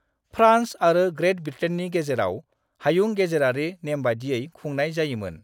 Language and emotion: Bodo, neutral